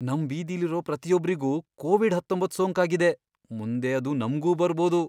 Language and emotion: Kannada, fearful